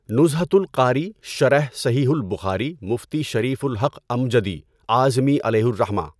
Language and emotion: Urdu, neutral